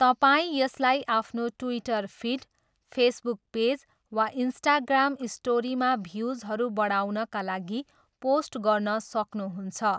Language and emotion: Nepali, neutral